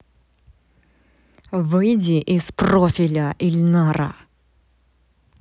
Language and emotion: Russian, angry